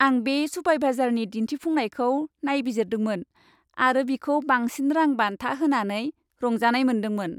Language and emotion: Bodo, happy